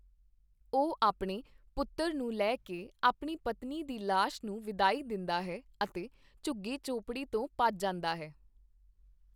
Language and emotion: Punjabi, neutral